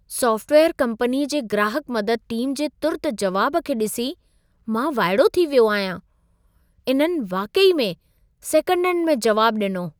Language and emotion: Sindhi, surprised